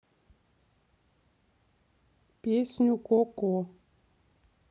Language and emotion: Russian, neutral